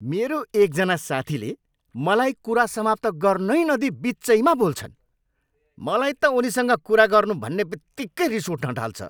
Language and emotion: Nepali, angry